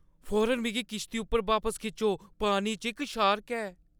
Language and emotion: Dogri, fearful